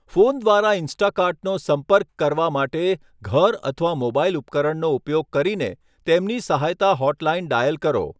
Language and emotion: Gujarati, neutral